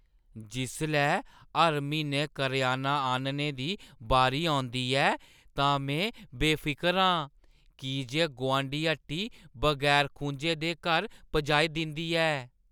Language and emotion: Dogri, happy